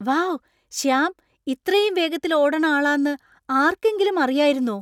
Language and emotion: Malayalam, surprised